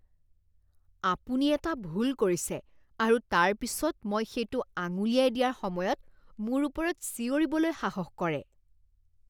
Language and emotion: Assamese, disgusted